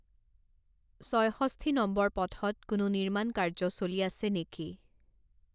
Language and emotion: Assamese, neutral